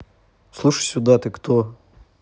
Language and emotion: Russian, angry